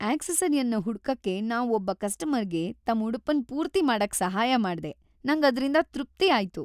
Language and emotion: Kannada, happy